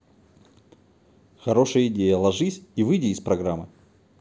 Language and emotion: Russian, positive